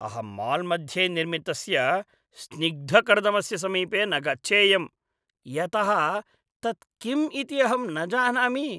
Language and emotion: Sanskrit, disgusted